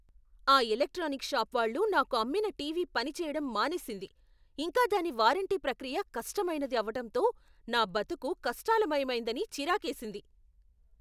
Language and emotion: Telugu, angry